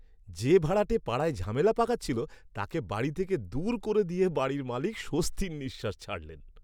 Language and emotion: Bengali, happy